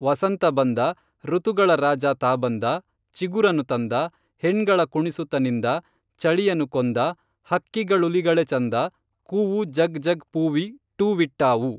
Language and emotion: Kannada, neutral